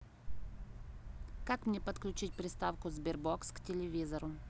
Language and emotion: Russian, neutral